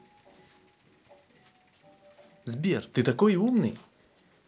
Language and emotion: Russian, positive